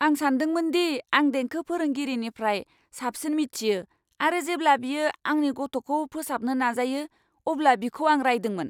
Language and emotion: Bodo, angry